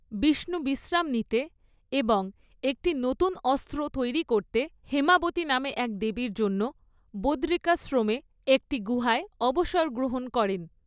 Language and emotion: Bengali, neutral